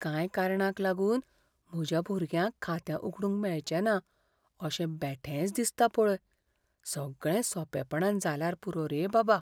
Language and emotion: Goan Konkani, fearful